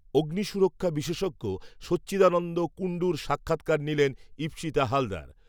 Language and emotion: Bengali, neutral